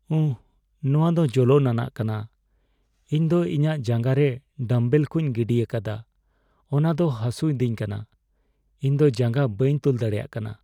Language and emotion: Santali, sad